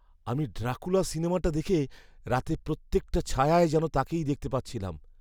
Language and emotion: Bengali, fearful